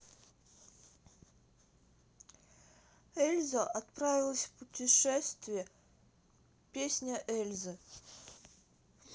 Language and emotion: Russian, neutral